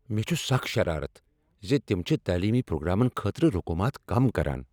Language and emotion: Kashmiri, angry